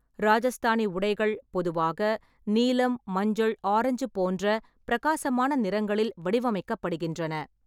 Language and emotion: Tamil, neutral